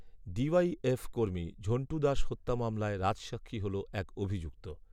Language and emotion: Bengali, neutral